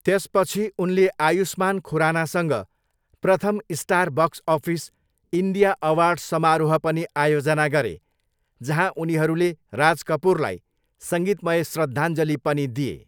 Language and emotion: Nepali, neutral